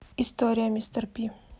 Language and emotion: Russian, neutral